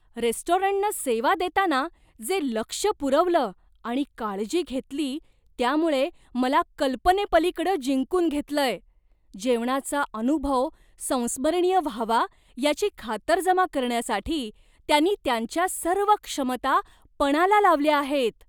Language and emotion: Marathi, surprised